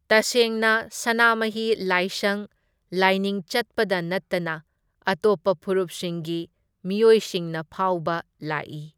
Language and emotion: Manipuri, neutral